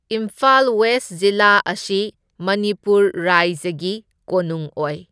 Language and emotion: Manipuri, neutral